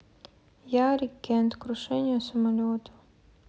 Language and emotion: Russian, sad